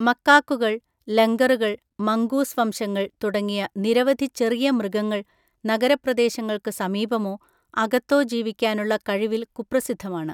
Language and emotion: Malayalam, neutral